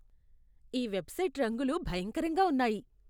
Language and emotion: Telugu, disgusted